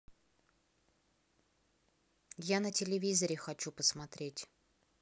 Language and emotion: Russian, angry